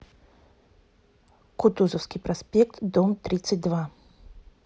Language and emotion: Russian, neutral